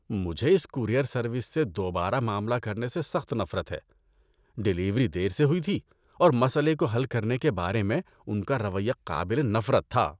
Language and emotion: Urdu, disgusted